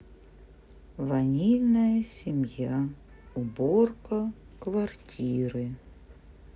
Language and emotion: Russian, sad